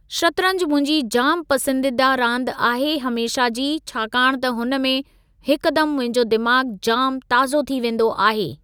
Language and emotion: Sindhi, neutral